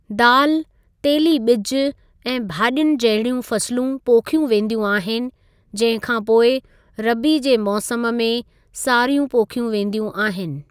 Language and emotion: Sindhi, neutral